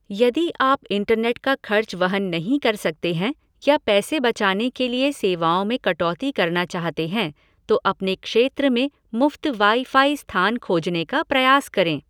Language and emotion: Hindi, neutral